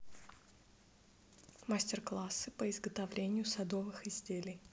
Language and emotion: Russian, neutral